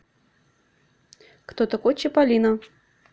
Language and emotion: Russian, neutral